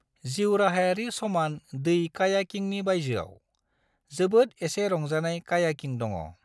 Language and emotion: Bodo, neutral